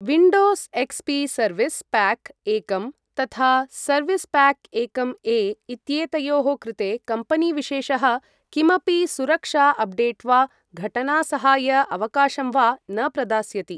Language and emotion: Sanskrit, neutral